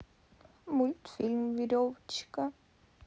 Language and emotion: Russian, sad